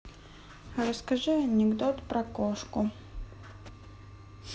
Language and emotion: Russian, neutral